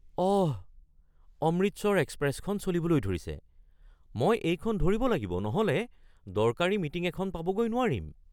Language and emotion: Assamese, surprised